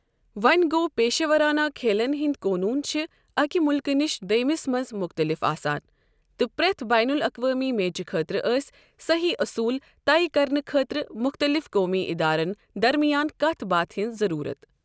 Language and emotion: Kashmiri, neutral